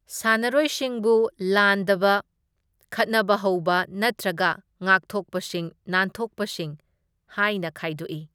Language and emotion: Manipuri, neutral